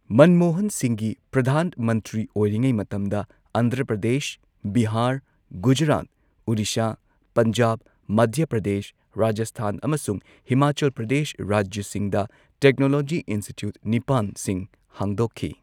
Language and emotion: Manipuri, neutral